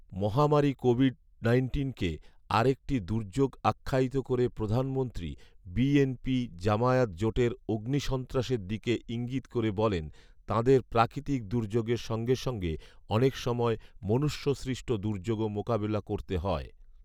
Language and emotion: Bengali, neutral